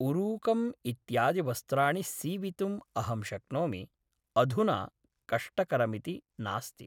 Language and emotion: Sanskrit, neutral